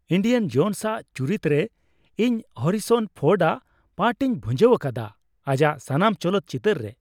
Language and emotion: Santali, happy